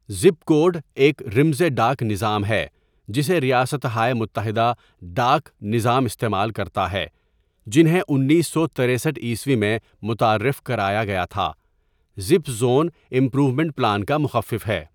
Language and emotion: Urdu, neutral